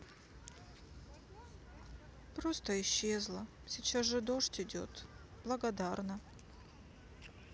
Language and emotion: Russian, sad